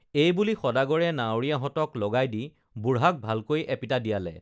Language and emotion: Assamese, neutral